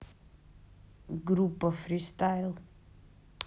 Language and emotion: Russian, neutral